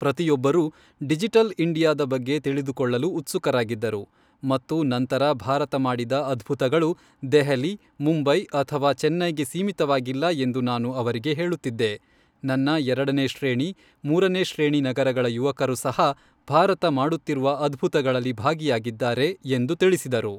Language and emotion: Kannada, neutral